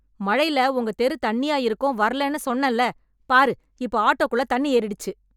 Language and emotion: Tamil, angry